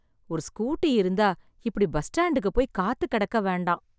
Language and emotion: Tamil, sad